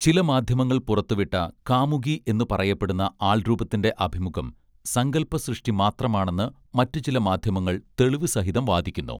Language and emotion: Malayalam, neutral